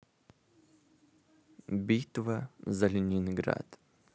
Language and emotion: Russian, neutral